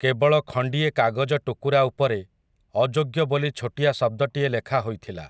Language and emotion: Odia, neutral